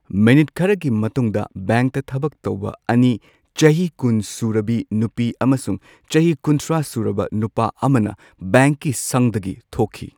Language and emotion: Manipuri, neutral